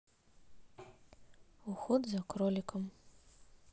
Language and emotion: Russian, neutral